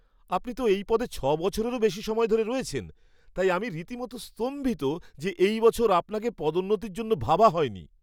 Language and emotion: Bengali, surprised